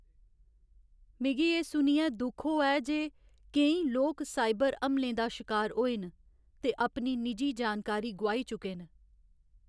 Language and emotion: Dogri, sad